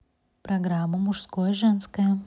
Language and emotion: Russian, positive